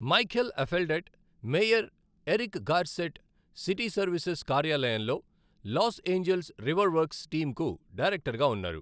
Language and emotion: Telugu, neutral